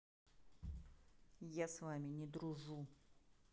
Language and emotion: Russian, neutral